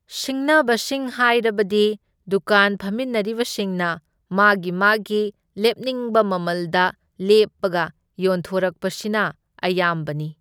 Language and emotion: Manipuri, neutral